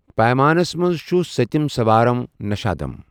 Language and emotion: Kashmiri, neutral